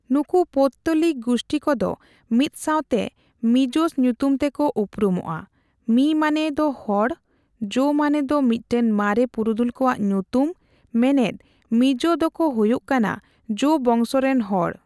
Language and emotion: Santali, neutral